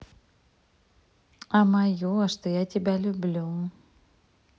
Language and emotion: Russian, positive